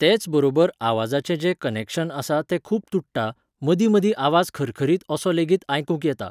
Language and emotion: Goan Konkani, neutral